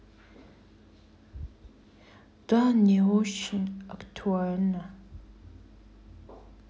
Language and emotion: Russian, sad